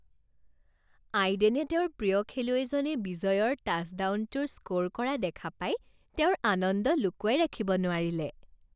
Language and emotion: Assamese, happy